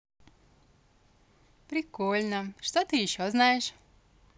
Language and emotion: Russian, positive